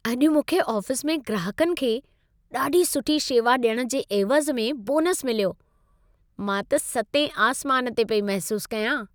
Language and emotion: Sindhi, happy